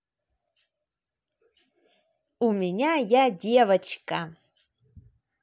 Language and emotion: Russian, positive